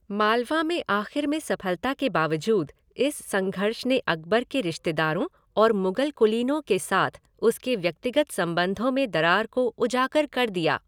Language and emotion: Hindi, neutral